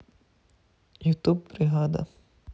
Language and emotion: Russian, neutral